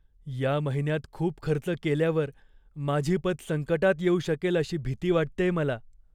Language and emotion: Marathi, fearful